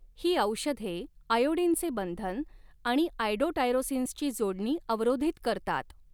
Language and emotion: Marathi, neutral